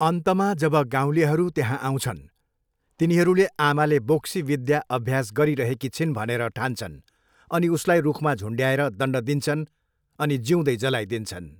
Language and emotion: Nepali, neutral